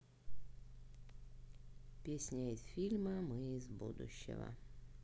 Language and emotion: Russian, sad